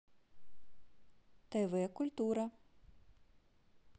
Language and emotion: Russian, neutral